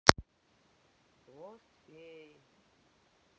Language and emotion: Russian, neutral